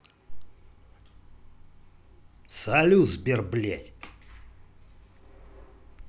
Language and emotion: Russian, angry